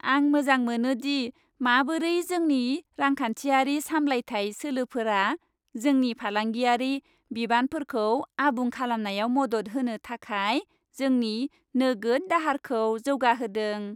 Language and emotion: Bodo, happy